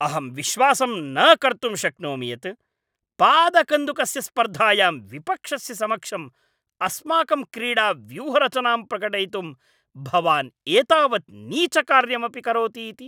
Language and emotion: Sanskrit, angry